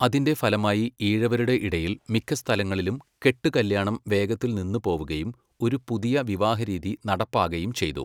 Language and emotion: Malayalam, neutral